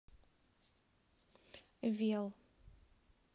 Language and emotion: Russian, neutral